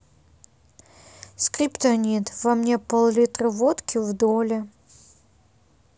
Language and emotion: Russian, sad